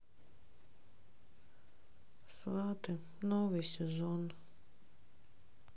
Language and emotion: Russian, sad